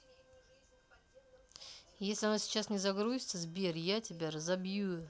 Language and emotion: Russian, angry